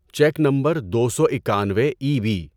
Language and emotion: Urdu, neutral